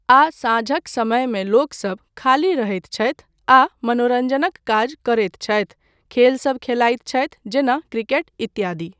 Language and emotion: Maithili, neutral